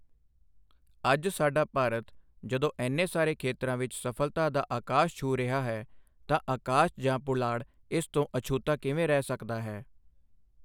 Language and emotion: Punjabi, neutral